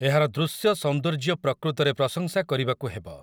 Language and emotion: Odia, neutral